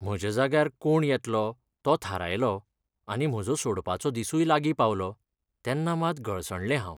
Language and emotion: Goan Konkani, sad